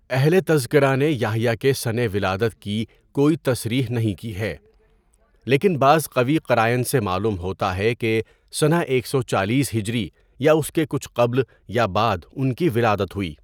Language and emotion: Urdu, neutral